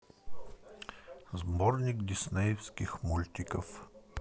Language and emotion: Russian, neutral